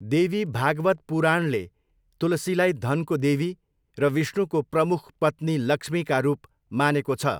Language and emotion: Nepali, neutral